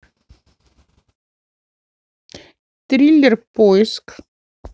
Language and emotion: Russian, neutral